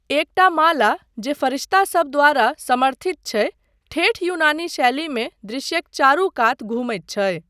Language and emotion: Maithili, neutral